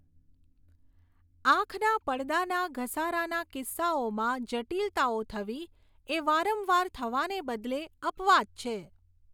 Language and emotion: Gujarati, neutral